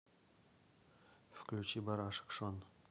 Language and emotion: Russian, neutral